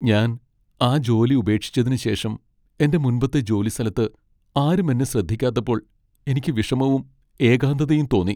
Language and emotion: Malayalam, sad